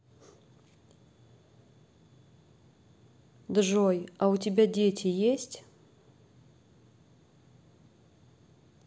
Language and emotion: Russian, neutral